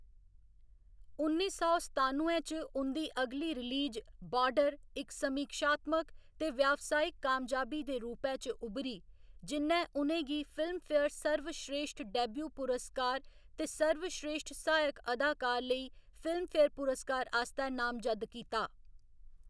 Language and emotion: Dogri, neutral